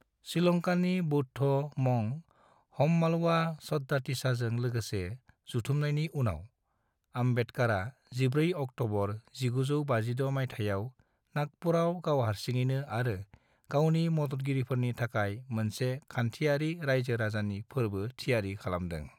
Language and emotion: Bodo, neutral